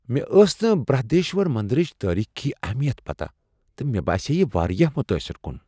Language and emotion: Kashmiri, surprised